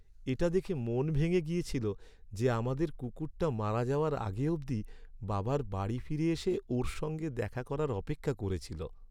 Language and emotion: Bengali, sad